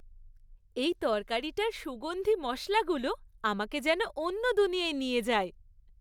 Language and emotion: Bengali, happy